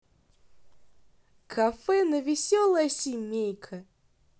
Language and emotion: Russian, positive